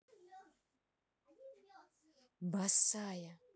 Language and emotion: Russian, neutral